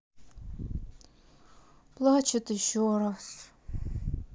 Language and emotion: Russian, sad